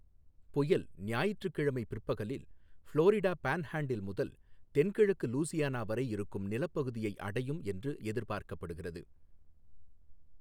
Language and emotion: Tamil, neutral